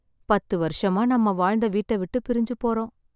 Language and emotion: Tamil, sad